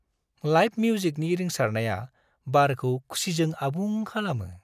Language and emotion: Bodo, happy